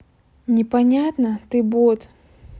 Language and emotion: Russian, neutral